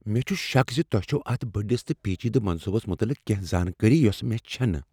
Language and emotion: Kashmiri, fearful